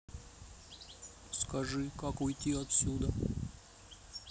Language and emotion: Russian, neutral